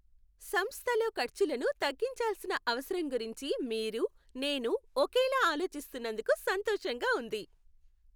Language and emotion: Telugu, happy